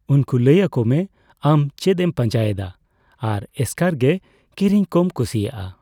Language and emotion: Santali, neutral